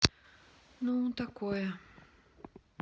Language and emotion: Russian, sad